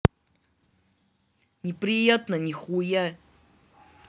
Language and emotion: Russian, angry